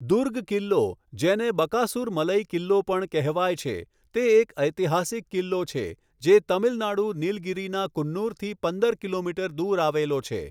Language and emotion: Gujarati, neutral